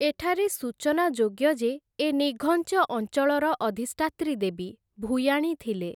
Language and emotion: Odia, neutral